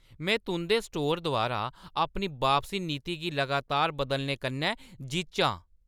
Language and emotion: Dogri, angry